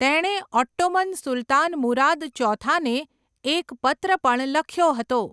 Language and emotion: Gujarati, neutral